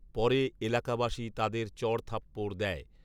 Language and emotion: Bengali, neutral